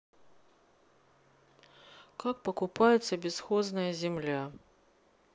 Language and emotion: Russian, neutral